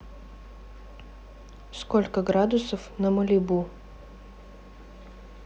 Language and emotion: Russian, neutral